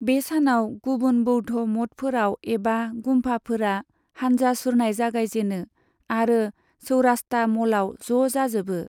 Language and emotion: Bodo, neutral